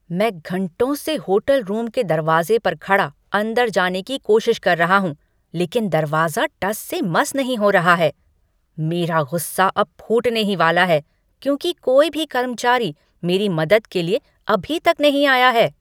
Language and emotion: Hindi, angry